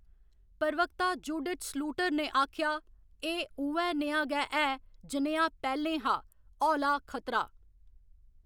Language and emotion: Dogri, neutral